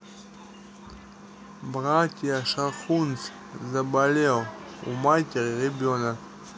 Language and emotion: Russian, neutral